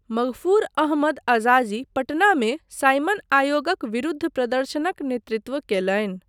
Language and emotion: Maithili, neutral